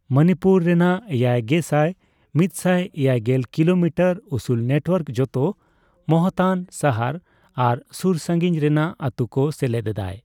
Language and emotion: Santali, neutral